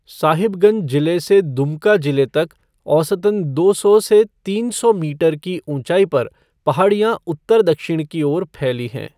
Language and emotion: Hindi, neutral